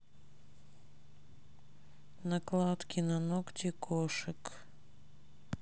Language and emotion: Russian, neutral